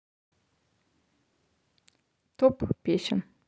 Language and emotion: Russian, neutral